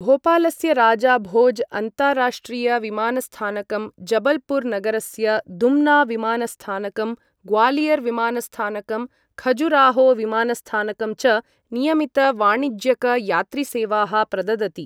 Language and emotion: Sanskrit, neutral